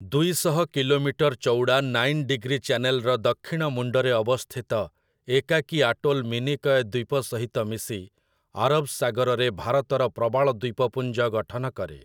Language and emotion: Odia, neutral